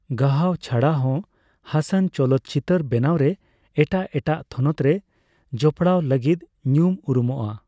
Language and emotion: Santali, neutral